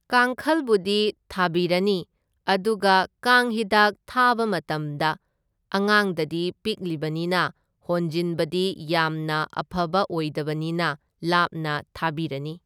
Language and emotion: Manipuri, neutral